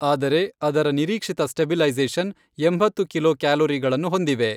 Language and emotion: Kannada, neutral